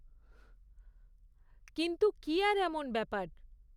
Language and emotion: Bengali, neutral